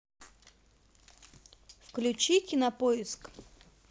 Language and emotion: Russian, neutral